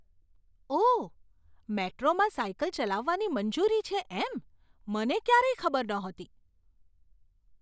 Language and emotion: Gujarati, surprised